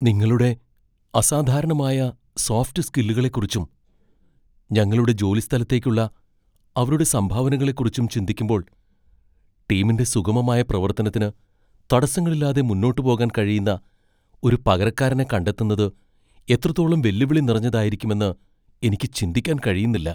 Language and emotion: Malayalam, fearful